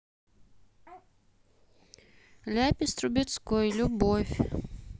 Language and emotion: Russian, neutral